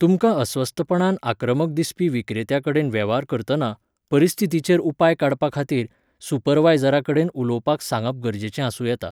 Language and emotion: Goan Konkani, neutral